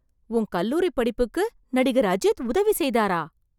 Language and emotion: Tamil, surprised